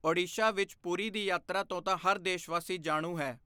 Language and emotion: Punjabi, neutral